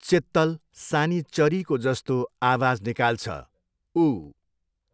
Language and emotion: Nepali, neutral